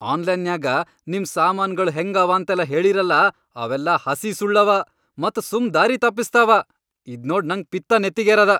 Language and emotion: Kannada, angry